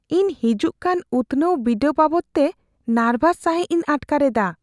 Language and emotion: Santali, fearful